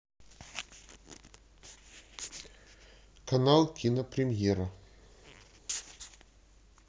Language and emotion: Russian, neutral